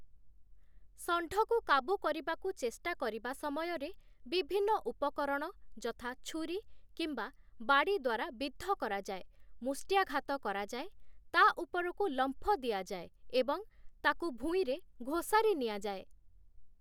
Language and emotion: Odia, neutral